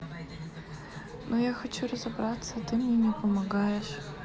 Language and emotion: Russian, sad